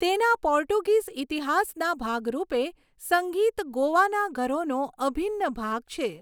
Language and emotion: Gujarati, neutral